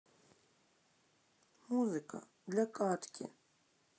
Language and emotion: Russian, sad